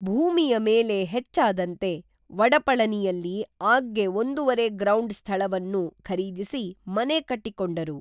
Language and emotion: Kannada, neutral